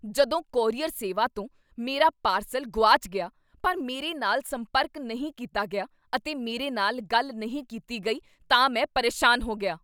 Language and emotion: Punjabi, angry